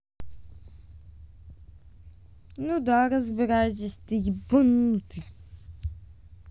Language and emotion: Russian, angry